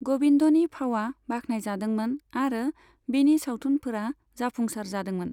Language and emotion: Bodo, neutral